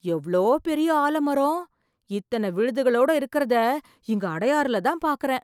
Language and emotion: Tamil, surprised